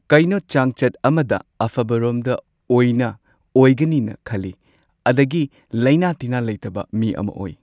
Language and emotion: Manipuri, neutral